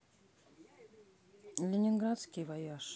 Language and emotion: Russian, neutral